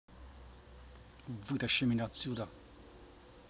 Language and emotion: Russian, angry